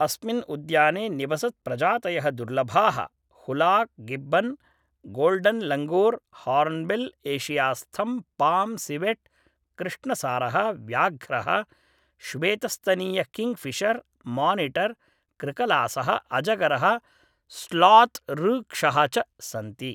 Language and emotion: Sanskrit, neutral